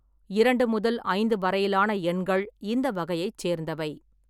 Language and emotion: Tamil, neutral